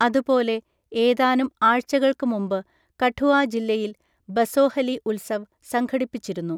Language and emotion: Malayalam, neutral